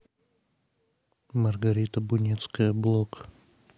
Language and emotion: Russian, neutral